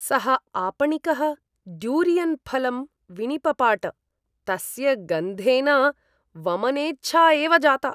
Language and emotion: Sanskrit, disgusted